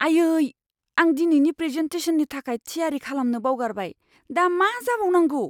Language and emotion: Bodo, fearful